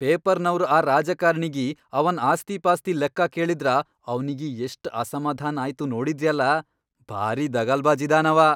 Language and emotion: Kannada, angry